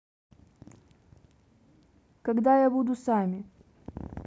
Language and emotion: Russian, neutral